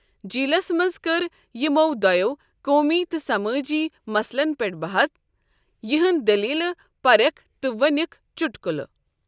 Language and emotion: Kashmiri, neutral